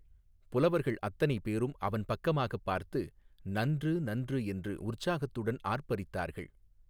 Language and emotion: Tamil, neutral